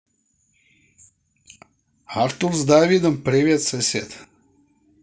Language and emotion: Russian, positive